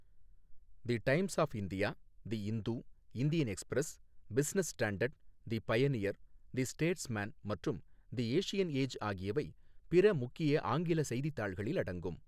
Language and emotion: Tamil, neutral